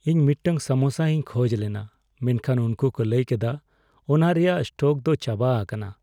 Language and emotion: Santali, sad